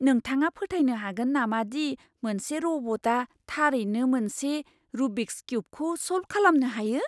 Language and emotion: Bodo, surprised